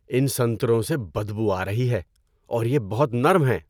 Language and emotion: Urdu, disgusted